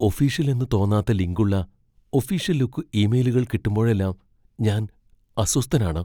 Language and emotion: Malayalam, fearful